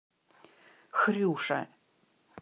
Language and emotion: Russian, angry